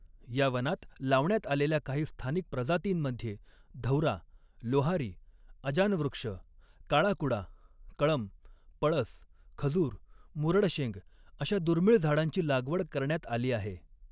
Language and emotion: Marathi, neutral